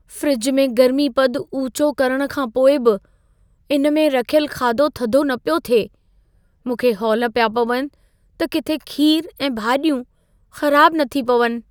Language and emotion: Sindhi, fearful